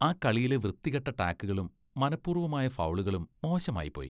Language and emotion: Malayalam, disgusted